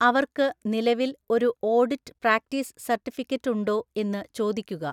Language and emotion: Malayalam, neutral